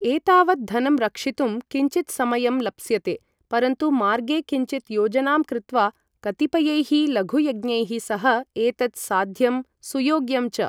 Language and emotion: Sanskrit, neutral